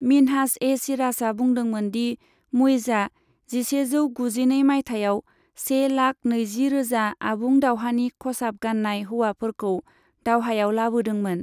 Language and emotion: Bodo, neutral